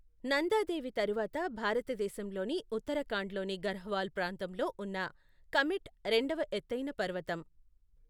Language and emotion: Telugu, neutral